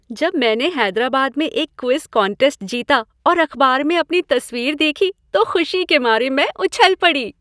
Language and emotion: Hindi, happy